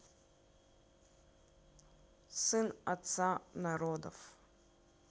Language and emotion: Russian, neutral